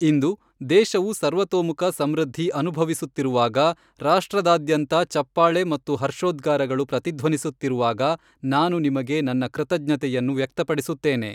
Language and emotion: Kannada, neutral